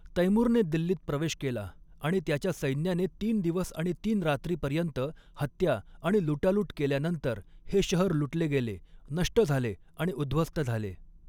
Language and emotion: Marathi, neutral